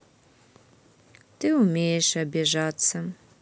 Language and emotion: Russian, sad